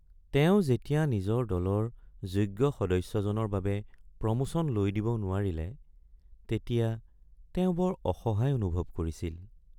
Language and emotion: Assamese, sad